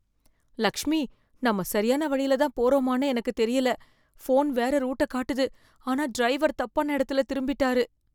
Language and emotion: Tamil, fearful